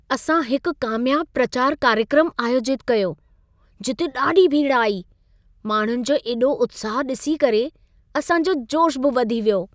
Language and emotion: Sindhi, happy